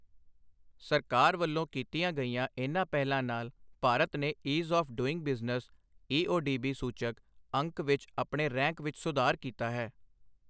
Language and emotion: Punjabi, neutral